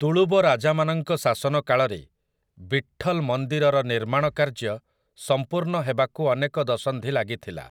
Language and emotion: Odia, neutral